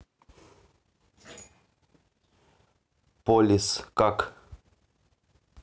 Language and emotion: Russian, neutral